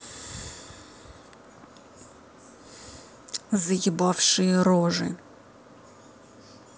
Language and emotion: Russian, angry